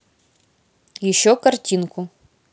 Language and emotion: Russian, neutral